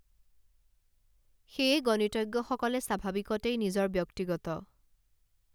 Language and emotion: Assamese, neutral